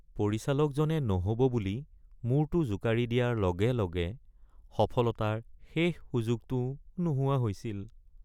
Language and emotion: Assamese, sad